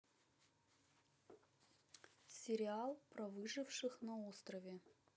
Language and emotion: Russian, neutral